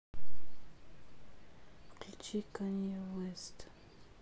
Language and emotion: Russian, sad